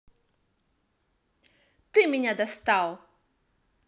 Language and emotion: Russian, angry